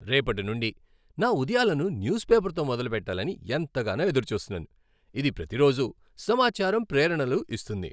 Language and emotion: Telugu, happy